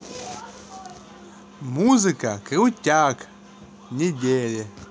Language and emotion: Russian, positive